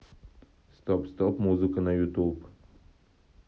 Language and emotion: Russian, neutral